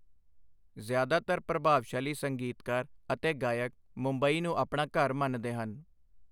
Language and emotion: Punjabi, neutral